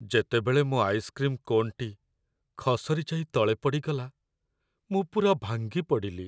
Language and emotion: Odia, sad